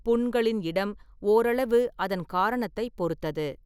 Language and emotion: Tamil, neutral